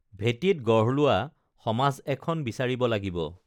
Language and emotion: Assamese, neutral